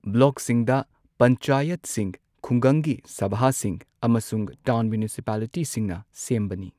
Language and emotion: Manipuri, neutral